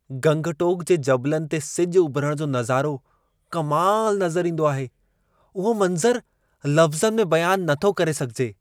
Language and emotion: Sindhi, surprised